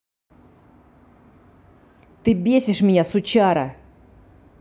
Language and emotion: Russian, angry